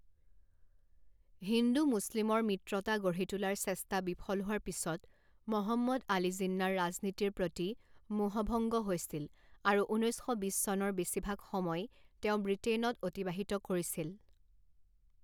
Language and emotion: Assamese, neutral